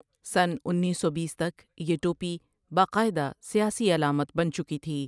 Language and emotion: Urdu, neutral